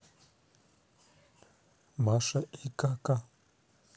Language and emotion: Russian, neutral